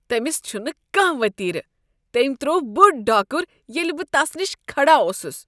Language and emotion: Kashmiri, disgusted